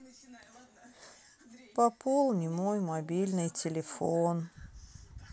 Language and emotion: Russian, sad